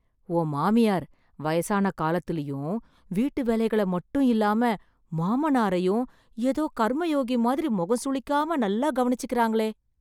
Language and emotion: Tamil, surprised